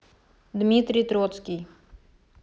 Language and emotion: Russian, neutral